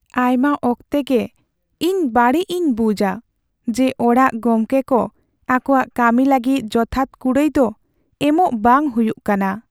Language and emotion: Santali, sad